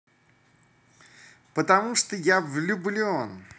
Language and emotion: Russian, positive